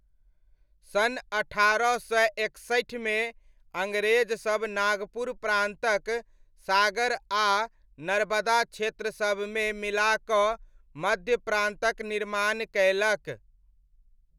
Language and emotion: Maithili, neutral